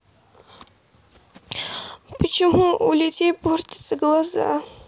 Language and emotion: Russian, sad